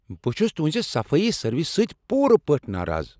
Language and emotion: Kashmiri, angry